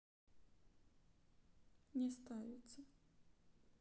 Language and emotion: Russian, sad